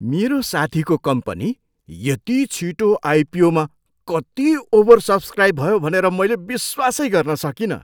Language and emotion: Nepali, surprised